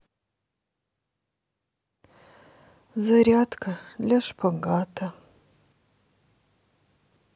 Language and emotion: Russian, sad